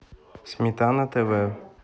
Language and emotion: Russian, neutral